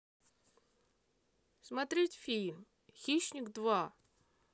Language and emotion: Russian, neutral